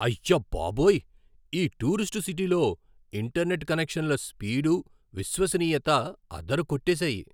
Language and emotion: Telugu, surprised